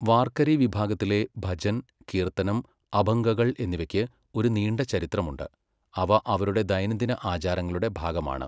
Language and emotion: Malayalam, neutral